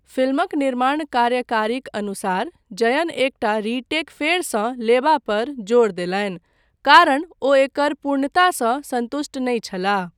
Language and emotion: Maithili, neutral